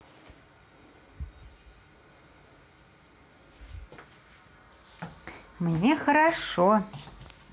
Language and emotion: Russian, positive